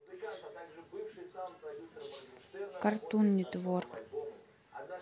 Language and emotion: Russian, neutral